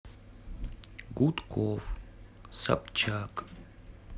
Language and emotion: Russian, neutral